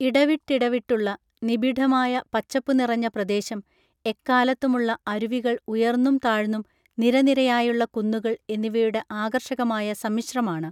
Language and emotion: Malayalam, neutral